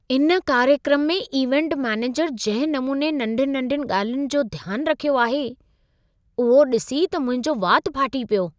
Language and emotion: Sindhi, surprised